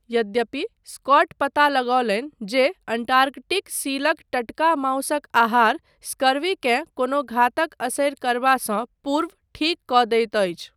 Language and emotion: Maithili, neutral